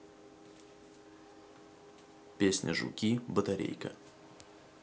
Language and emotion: Russian, neutral